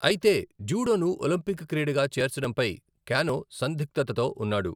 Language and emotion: Telugu, neutral